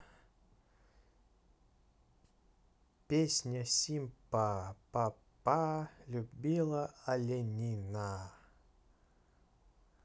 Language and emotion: Russian, neutral